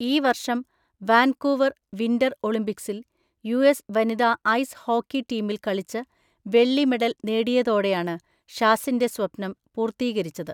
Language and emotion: Malayalam, neutral